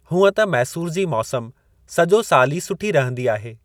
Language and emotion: Sindhi, neutral